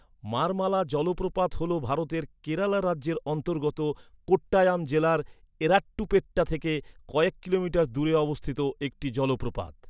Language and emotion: Bengali, neutral